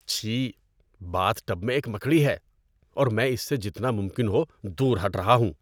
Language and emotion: Urdu, disgusted